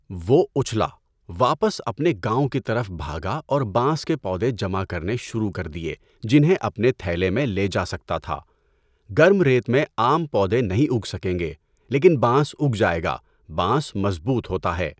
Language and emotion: Urdu, neutral